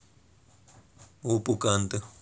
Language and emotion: Russian, neutral